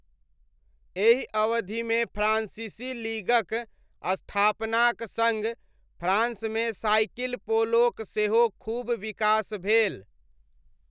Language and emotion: Maithili, neutral